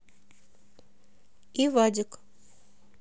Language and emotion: Russian, neutral